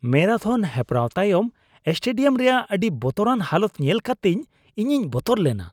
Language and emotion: Santali, disgusted